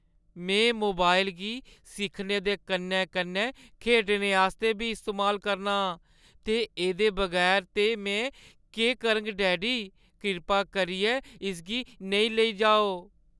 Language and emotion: Dogri, sad